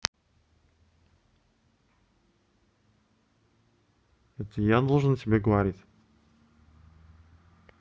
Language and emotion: Russian, neutral